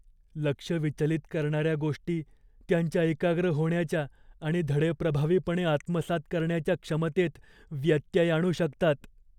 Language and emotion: Marathi, fearful